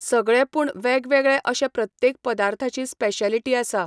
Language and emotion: Goan Konkani, neutral